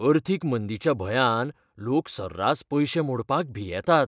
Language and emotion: Goan Konkani, fearful